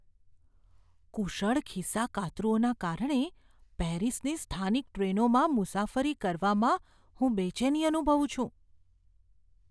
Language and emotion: Gujarati, fearful